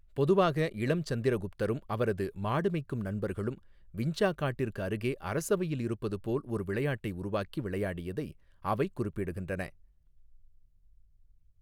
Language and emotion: Tamil, neutral